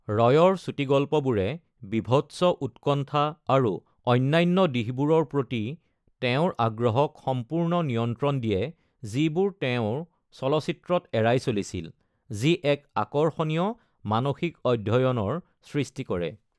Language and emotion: Assamese, neutral